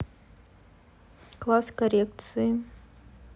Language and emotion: Russian, neutral